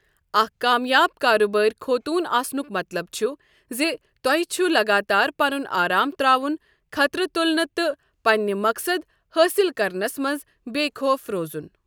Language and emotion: Kashmiri, neutral